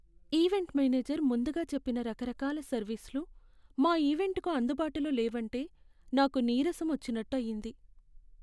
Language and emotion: Telugu, sad